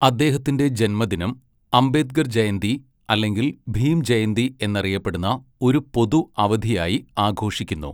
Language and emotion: Malayalam, neutral